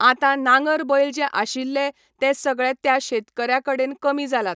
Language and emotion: Goan Konkani, neutral